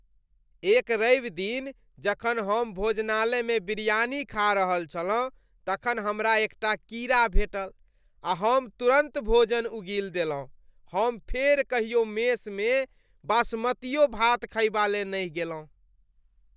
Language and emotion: Maithili, disgusted